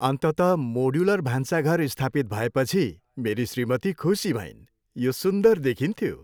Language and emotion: Nepali, happy